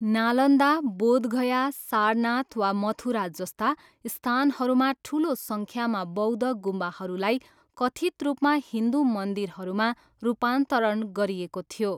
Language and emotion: Nepali, neutral